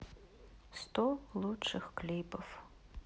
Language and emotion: Russian, sad